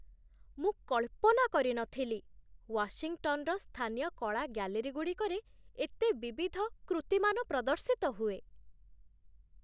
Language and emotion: Odia, surprised